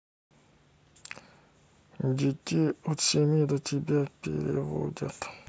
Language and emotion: Russian, sad